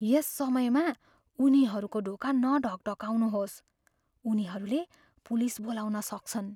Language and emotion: Nepali, fearful